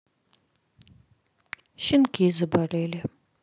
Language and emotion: Russian, sad